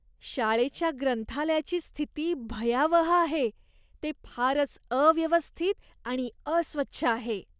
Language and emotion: Marathi, disgusted